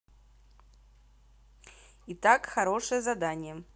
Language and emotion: Russian, positive